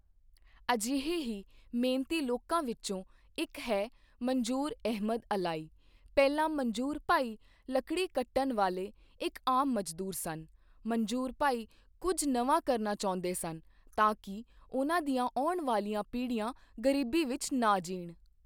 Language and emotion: Punjabi, neutral